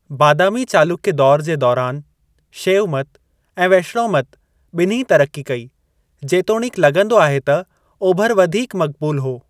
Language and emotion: Sindhi, neutral